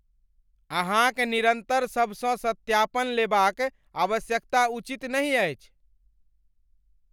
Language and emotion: Maithili, angry